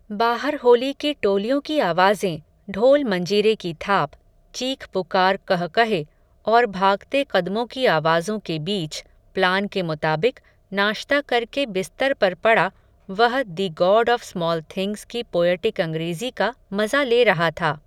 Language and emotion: Hindi, neutral